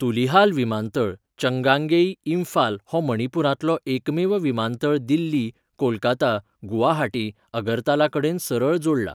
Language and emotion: Goan Konkani, neutral